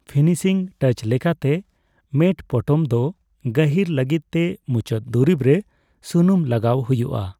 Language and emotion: Santali, neutral